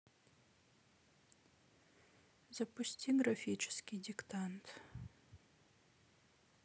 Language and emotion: Russian, sad